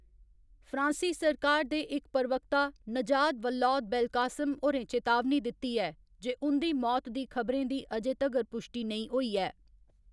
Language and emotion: Dogri, neutral